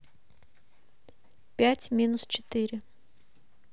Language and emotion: Russian, neutral